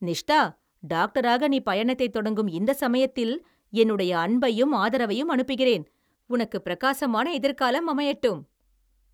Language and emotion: Tamil, happy